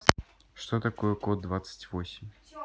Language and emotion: Russian, neutral